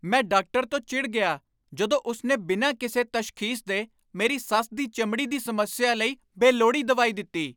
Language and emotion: Punjabi, angry